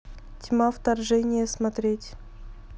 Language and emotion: Russian, neutral